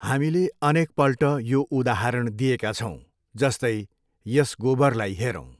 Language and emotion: Nepali, neutral